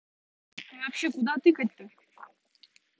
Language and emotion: Russian, angry